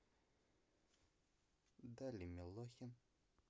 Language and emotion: Russian, neutral